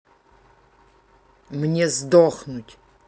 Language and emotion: Russian, angry